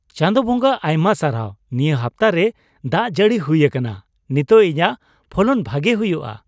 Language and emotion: Santali, happy